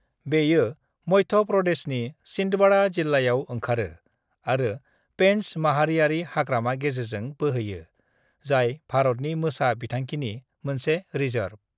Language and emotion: Bodo, neutral